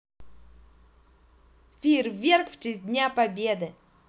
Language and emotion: Russian, positive